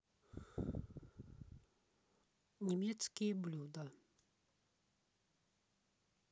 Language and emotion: Russian, neutral